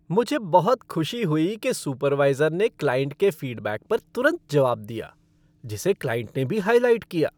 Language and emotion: Hindi, happy